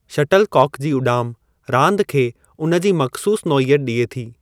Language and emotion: Sindhi, neutral